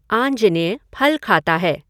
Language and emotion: Hindi, neutral